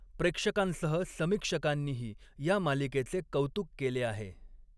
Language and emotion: Marathi, neutral